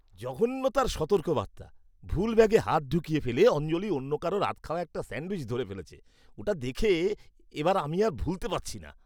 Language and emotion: Bengali, disgusted